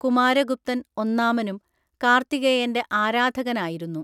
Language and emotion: Malayalam, neutral